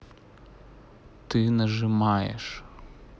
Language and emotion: Russian, neutral